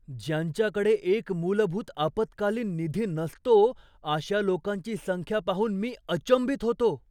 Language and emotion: Marathi, surprised